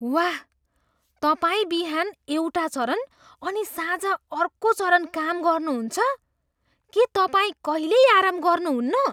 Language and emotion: Nepali, surprised